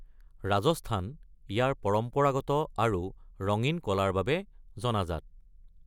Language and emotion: Assamese, neutral